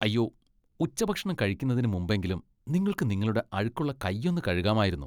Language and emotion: Malayalam, disgusted